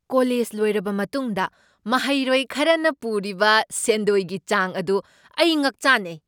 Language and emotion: Manipuri, surprised